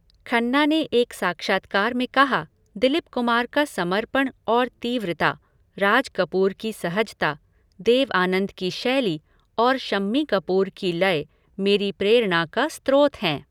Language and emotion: Hindi, neutral